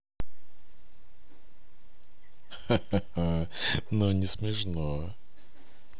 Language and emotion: Russian, positive